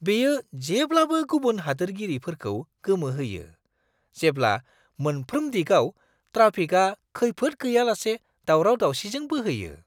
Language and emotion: Bodo, surprised